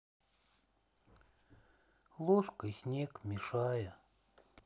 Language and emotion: Russian, sad